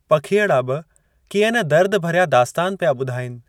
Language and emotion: Sindhi, neutral